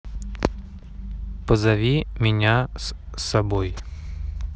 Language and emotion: Russian, neutral